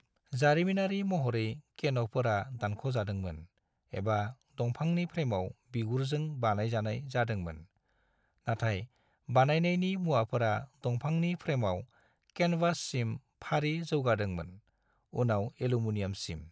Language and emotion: Bodo, neutral